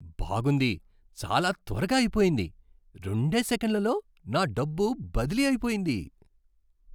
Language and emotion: Telugu, surprised